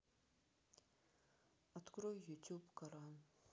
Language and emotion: Russian, sad